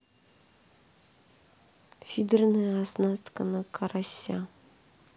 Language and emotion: Russian, neutral